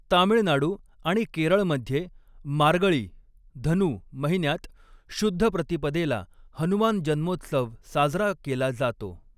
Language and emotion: Marathi, neutral